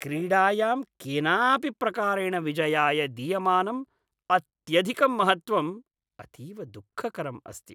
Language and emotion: Sanskrit, disgusted